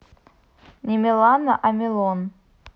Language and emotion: Russian, neutral